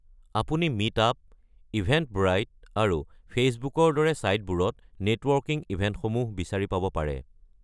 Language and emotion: Assamese, neutral